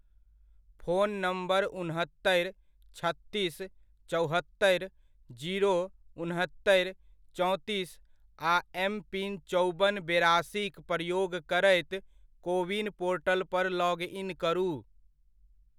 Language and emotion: Maithili, neutral